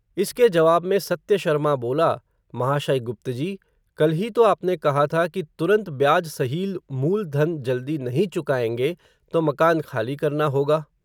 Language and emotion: Hindi, neutral